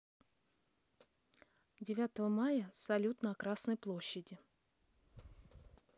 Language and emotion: Russian, neutral